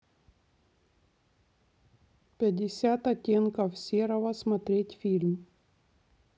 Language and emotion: Russian, neutral